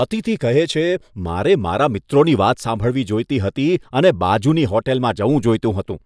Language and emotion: Gujarati, disgusted